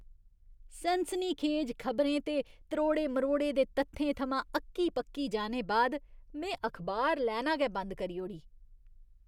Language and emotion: Dogri, disgusted